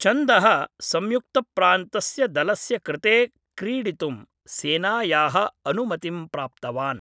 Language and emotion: Sanskrit, neutral